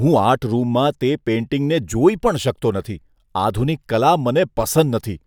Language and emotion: Gujarati, disgusted